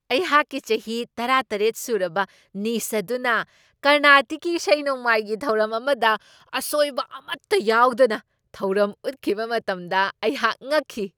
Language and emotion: Manipuri, surprised